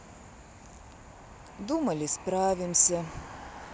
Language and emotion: Russian, sad